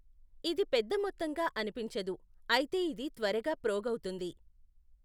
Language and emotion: Telugu, neutral